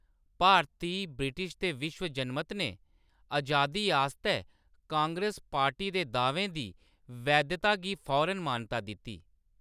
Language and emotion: Dogri, neutral